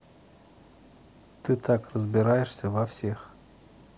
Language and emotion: Russian, neutral